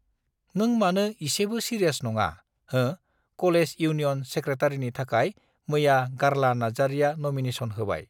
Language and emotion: Bodo, neutral